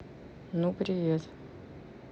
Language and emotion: Russian, neutral